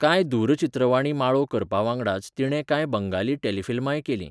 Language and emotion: Goan Konkani, neutral